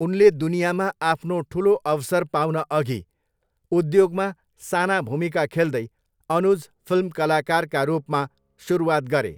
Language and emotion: Nepali, neutral